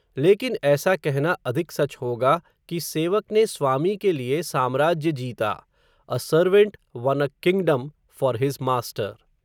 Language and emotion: Hindi, neutral